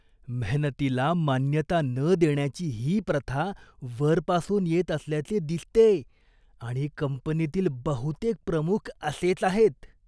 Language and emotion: Marathi, disgusted